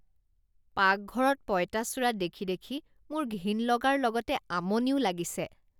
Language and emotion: Assamese, disgusted